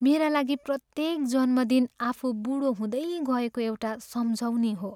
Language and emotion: Nepali, sad